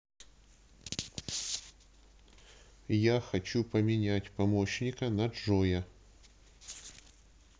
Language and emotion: Russian, neutral